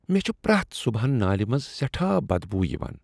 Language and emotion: Kashmiri, disgusted